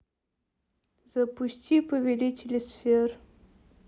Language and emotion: Russian, neutral